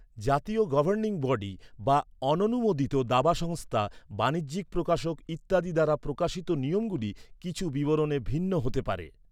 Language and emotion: Bengali, neutral